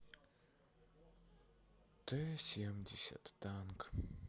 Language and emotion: Russian, sad